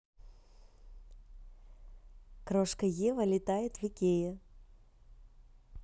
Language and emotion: Russian, positive